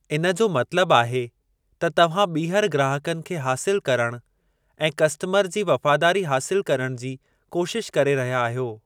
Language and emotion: Sindhi, neutral